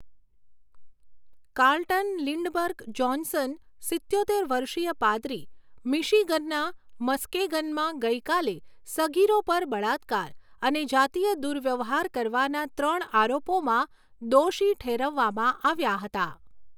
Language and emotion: Gujarati, neutral